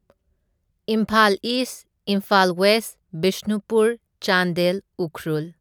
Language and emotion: Manipuri, neutral